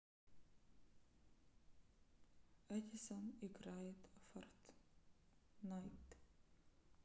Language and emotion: Russian, neutral